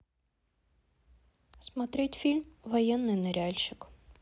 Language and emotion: Russian, neutral